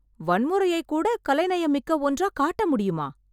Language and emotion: Tamil, surprised